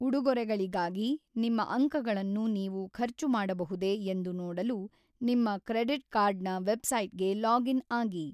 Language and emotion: Kannada, neutral